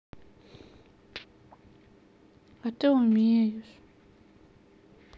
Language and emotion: Russian, sad